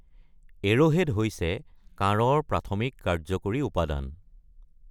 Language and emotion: Assamese, neutral